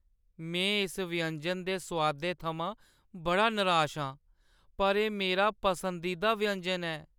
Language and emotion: Dogri, sad